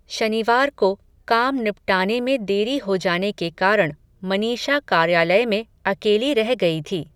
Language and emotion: Hindi, neutral